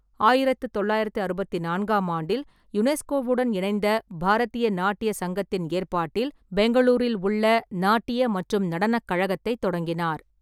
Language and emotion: Tamil, neutral